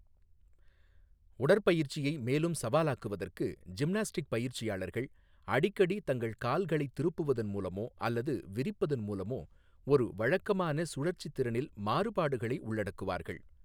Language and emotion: Tamil, neutral